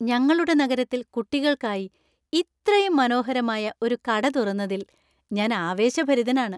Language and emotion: Malayalam, happy